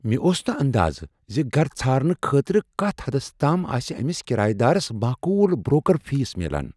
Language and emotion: Kashmiri, surprised